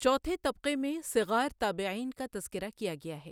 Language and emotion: Urdu, neutral